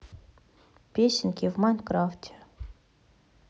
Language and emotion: Russian, neutral